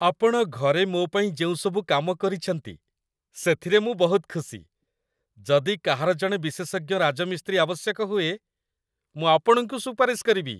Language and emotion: Odia, happy